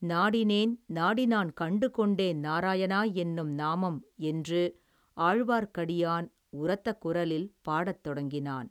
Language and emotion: Tamil, neutral